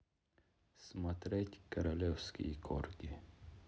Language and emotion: Russian, neutral